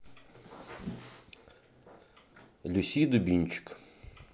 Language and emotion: Russian, neutral